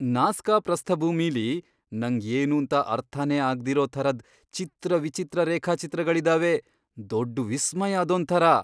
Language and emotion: Kannada, surprised